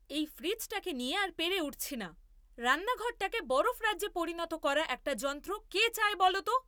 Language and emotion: Bengali, angry